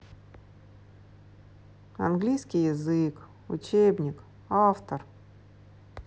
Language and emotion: Russian, sad